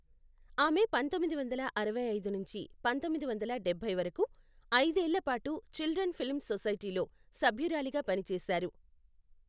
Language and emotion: Telugu, neutral